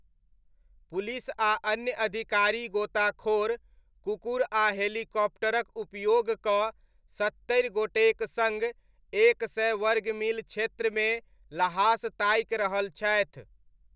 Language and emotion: Maithili, neutral